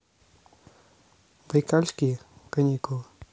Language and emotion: Russian, neutral